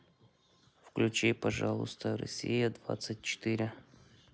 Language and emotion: Russian, neutral